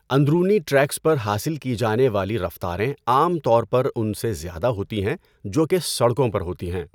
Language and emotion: Urdu, neutral